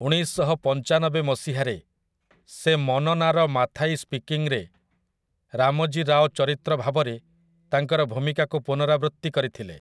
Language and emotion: Odia, neutral